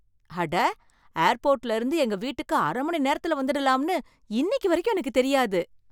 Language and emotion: Tamil, surprised